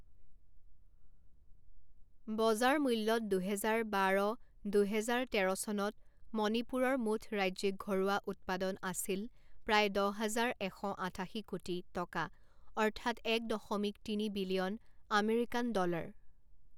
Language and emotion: Assamese, neutral